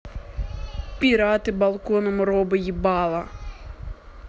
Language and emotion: Russian, angry